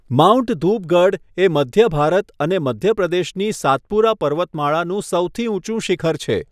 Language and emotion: Gujarati, neutral